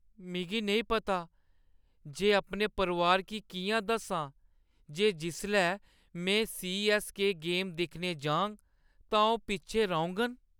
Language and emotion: Dogri, sad